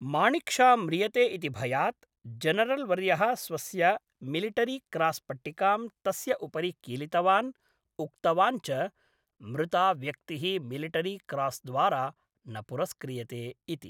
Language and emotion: Sanskrit, neutral